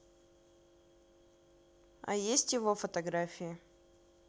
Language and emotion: Russian, neutral